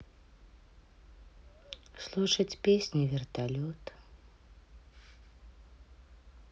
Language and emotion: Russian, sad